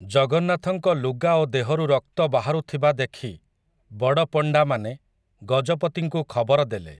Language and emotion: Odia, neutral